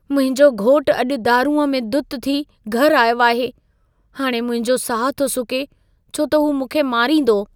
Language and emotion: Sindhi, fearful